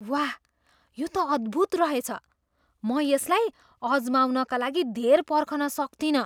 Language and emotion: Nepali, surprised